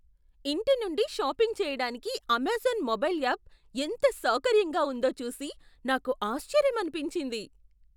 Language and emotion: Telugu, surprised